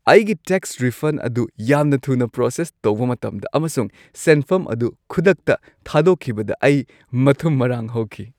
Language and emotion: Manipuri, happy